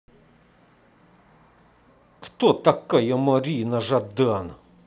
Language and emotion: Russian, angry